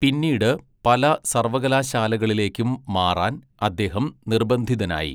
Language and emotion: Malayalam, neutral